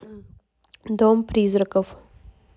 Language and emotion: Russian, neutral